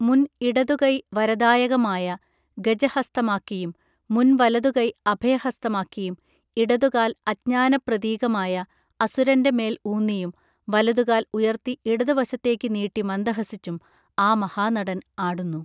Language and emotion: Malayalam, neutral